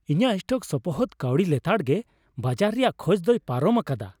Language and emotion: Santali, happy